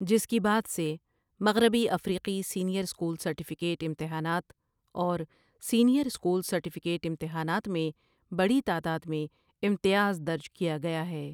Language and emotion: Urdu, neutral